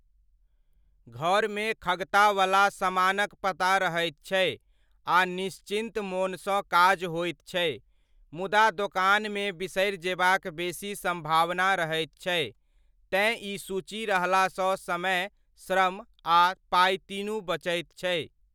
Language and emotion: Maithili, neutral